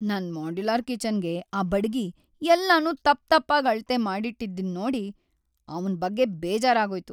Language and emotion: Kannada, sad